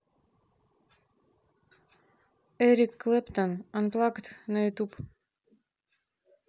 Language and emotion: Russian, neutral